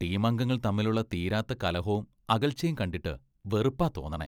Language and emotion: Malayalam, disgusted